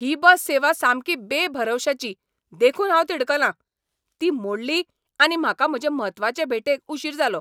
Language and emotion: Goan Konkani, angry